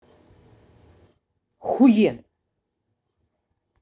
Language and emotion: Russian, angry